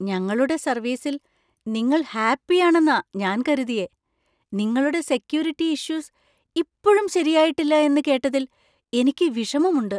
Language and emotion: Malayalam, surprised